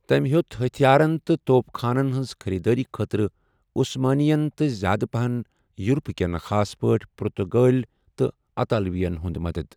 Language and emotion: Kashmiri, neutral